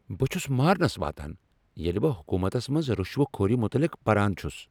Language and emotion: Kashmiri, angry